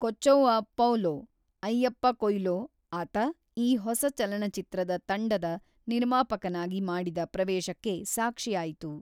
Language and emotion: Kannada, neutral